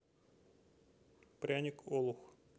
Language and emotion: Russian, neutral